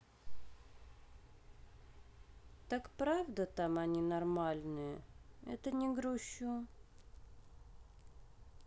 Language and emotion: Russian, sad